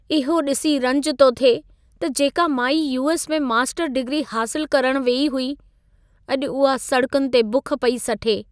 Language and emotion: Sindhi, sad